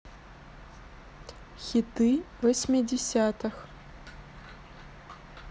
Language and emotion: Russian, neutral